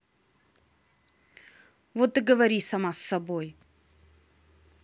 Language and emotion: Russian, angry